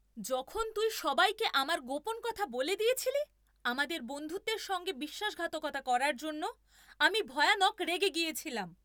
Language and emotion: Bengali, angry